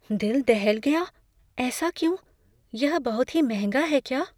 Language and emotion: Hindi, fearful